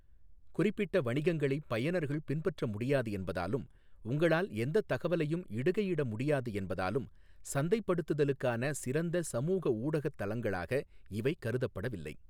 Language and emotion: Tamil, neutral